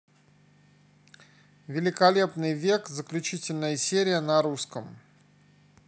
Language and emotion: Russian, neutral